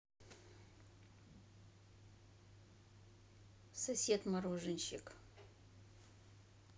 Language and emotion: Russian, neutral